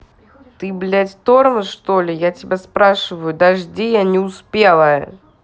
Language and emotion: Russian, angry